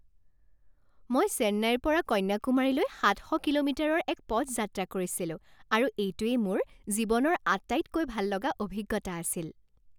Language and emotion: Assamese, happy